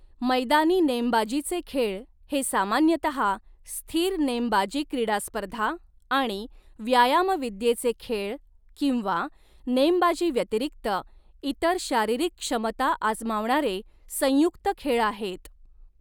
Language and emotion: Marathi, neutral